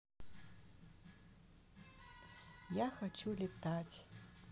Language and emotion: Russian, sad